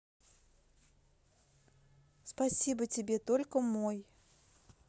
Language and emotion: Russian, positive